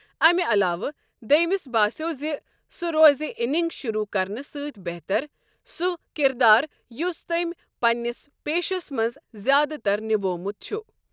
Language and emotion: Kashmiri, neutral